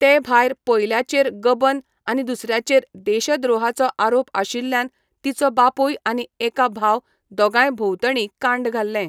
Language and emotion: Goan Konkani, neutral